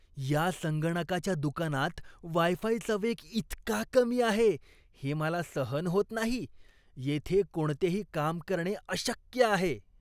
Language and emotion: Marathi, disgusted